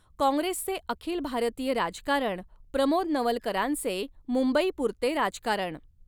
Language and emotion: Marathi, neutral